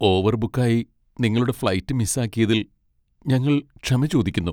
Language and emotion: Malayalam, sad